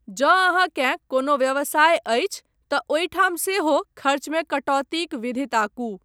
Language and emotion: Maithili, neutral